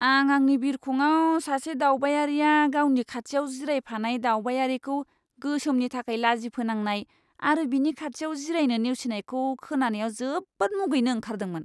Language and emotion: Bodo, disgusted